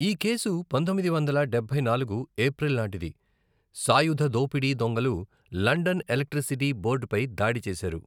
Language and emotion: Telugu, neutral